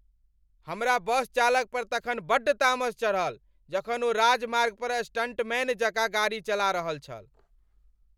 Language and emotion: Maithili, angry